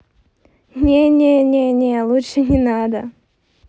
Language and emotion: Russian, positive